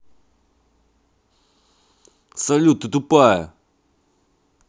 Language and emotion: Russian, angry